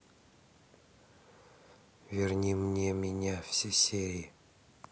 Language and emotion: Russian, neutral